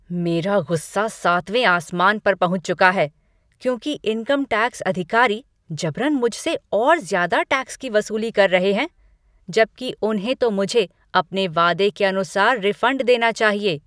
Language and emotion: Hindi, angry